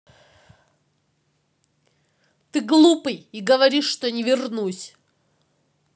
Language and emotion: Russian, angry